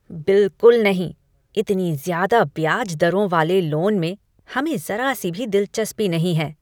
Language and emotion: Hindi, disgusted